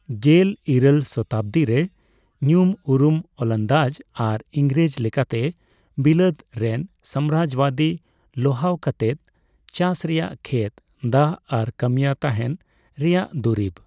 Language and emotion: Santali, neutral